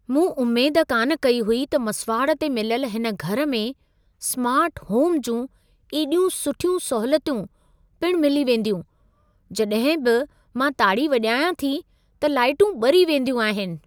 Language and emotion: Sindhi, surprised